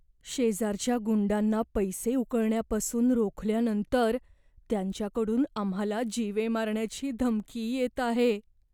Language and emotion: Marathi, fearful